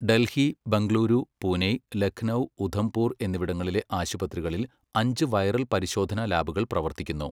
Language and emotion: Malayalam, neutral